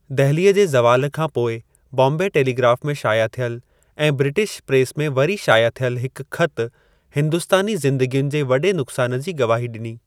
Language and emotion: Sindhi, neutral